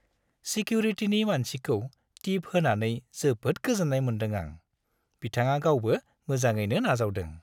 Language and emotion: Bodo, happy